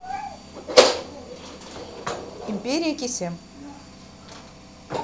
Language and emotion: Russian, neutral